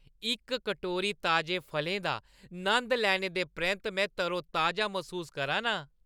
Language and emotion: Dogri, happy